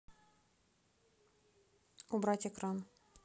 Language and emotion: Russian, neutral